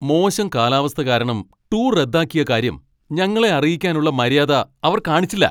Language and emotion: Malayalam, angry